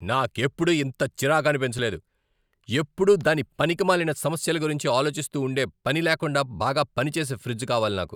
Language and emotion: Telugu, angry